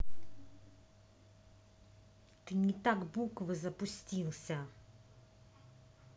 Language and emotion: Russian, angry